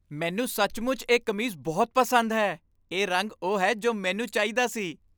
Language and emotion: Punjabi, happy